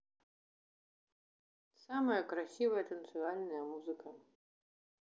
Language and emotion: Russian, neutral